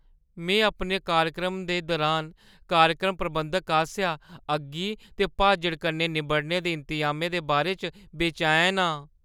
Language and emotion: Dogri, fearful